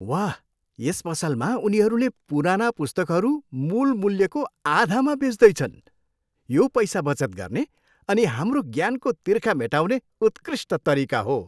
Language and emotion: Nepali, happy